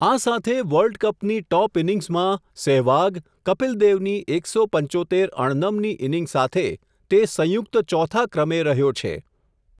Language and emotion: Gujarati, neutral